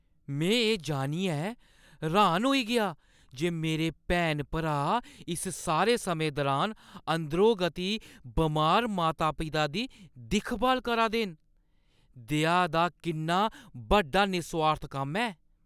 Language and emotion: Dogri, surprised